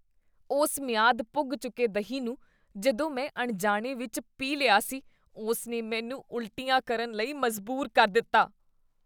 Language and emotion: Punjabi, disgusted